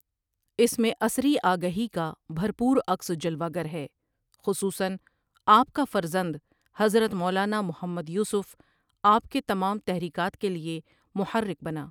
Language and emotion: Urdu, neutral